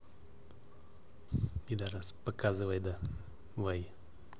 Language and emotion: Russian, neutral